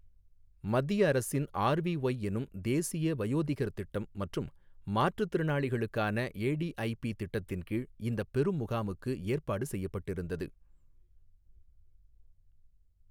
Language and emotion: Tamil, neutral